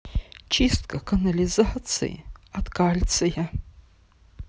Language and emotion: Russian, sad